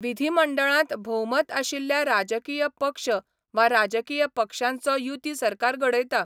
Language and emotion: Goan Konkani, neutral